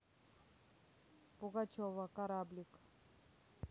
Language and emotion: Russian, neutral